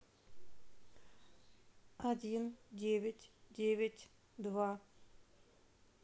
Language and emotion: Russian, neutral